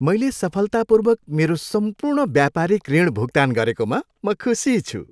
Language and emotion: Nepali, happy